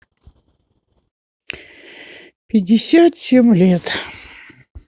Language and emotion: Russian, sad